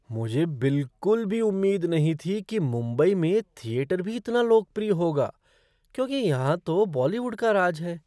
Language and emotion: Hindi, surprised